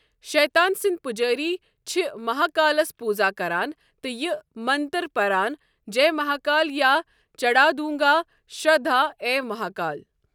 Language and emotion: Kashmiri, neutral